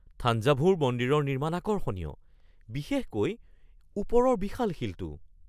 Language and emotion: Assamese, surprised